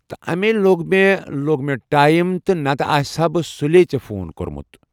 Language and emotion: Kashmiri, neutral